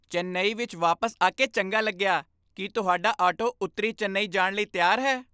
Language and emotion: Punjabi, happy